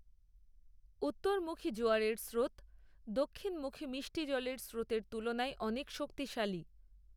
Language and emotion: Bengali, neutral